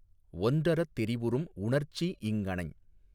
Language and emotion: Tamil, neutral